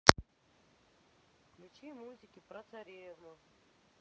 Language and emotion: Russian, neutral